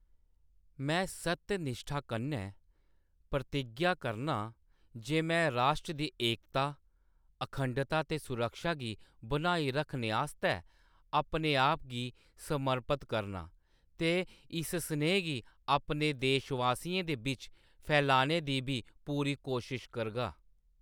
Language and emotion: Dogri, neutral